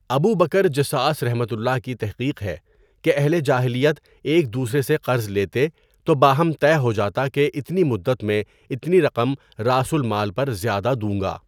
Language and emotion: Urdu, neutral